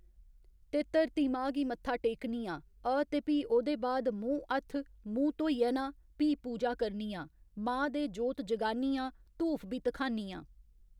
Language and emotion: Dogri, neutral